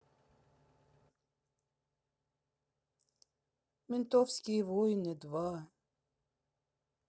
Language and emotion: Russian, sad